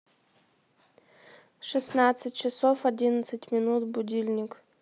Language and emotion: Russian, neutral